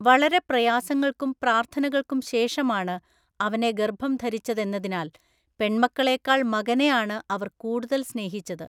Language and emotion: Malayalam, neutral